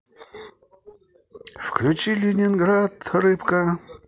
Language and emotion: Russian, positive